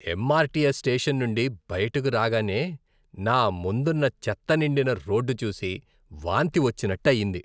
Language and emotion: Telugu, disgusted